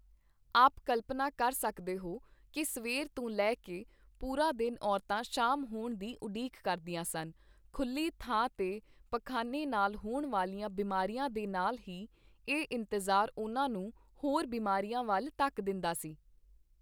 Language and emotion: Punjabi, neutral